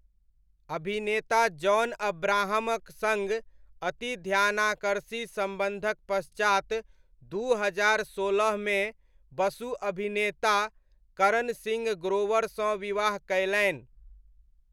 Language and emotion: Maithili, neutral